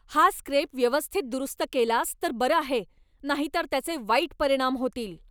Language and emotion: Marathi, angry